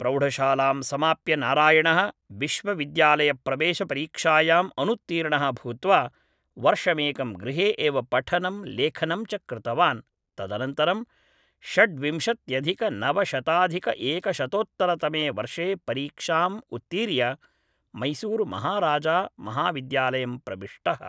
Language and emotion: Sanskrit, neutral